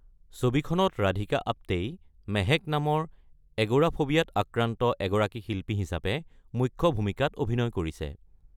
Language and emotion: Assamese, neutral